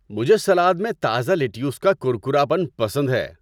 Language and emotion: Urdu, happy